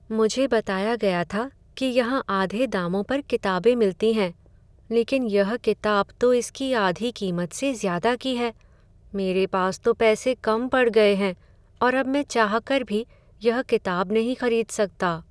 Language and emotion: Hindi, sad